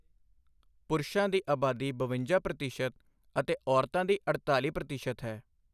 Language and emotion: Punjabi, neutral